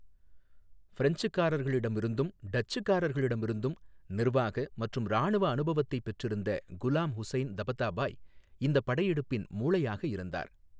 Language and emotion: Tamil, neutral